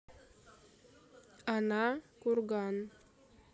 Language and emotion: Russian, neutral